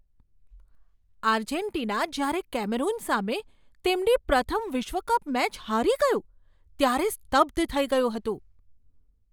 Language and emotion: Gujarati, surprised